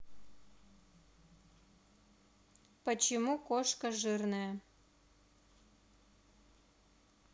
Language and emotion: Russian, neutral